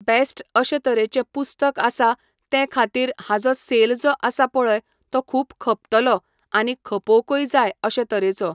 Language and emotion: Goan Konkani, neutral